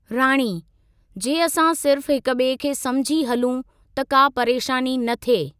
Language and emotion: Sindhi, neutral